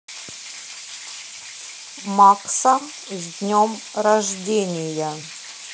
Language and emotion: Russian, neutral